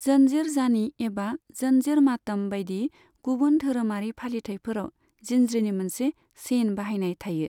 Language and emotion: Bodo, neutral